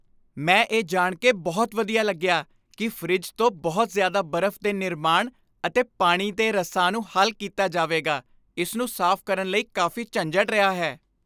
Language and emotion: Punjabi, happy